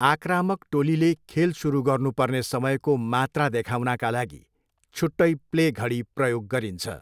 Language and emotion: Nepali, neutral